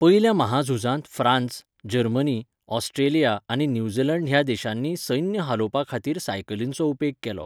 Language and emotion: Goan Konkani, neutral